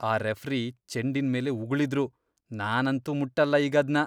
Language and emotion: Kannada, disgusted